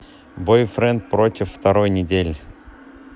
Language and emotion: Russian, neutral